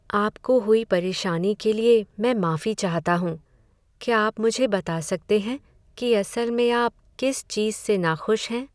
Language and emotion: Hindi, sad